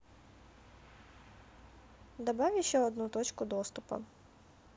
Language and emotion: Russian, neutral